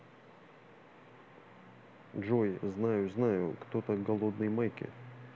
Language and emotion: Russian, neutral